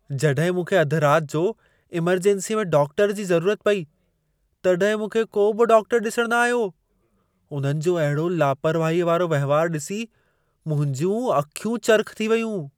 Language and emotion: Sindhi, surprised